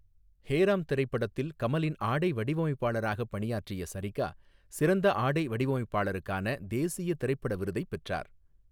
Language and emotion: Tamil, neutral